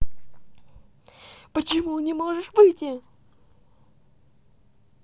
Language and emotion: Russian, angry